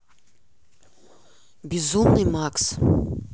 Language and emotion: Russian, neutral